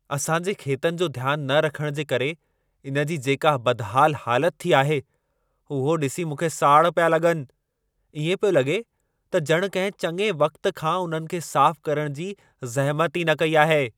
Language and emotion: Sindhi, angry